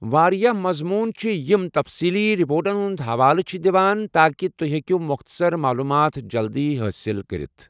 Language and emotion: Kashmiri, neutral